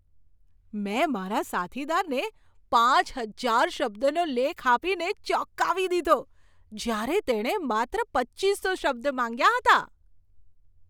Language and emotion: Gujarati, surprised